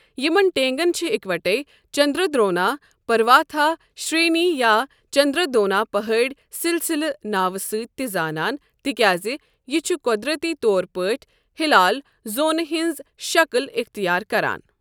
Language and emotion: Kashmiri, neutral